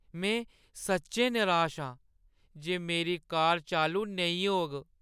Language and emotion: Dogri, sad